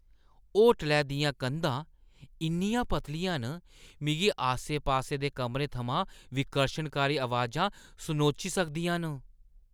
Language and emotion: Dogri, disgusted